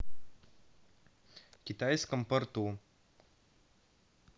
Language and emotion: Russian, neutral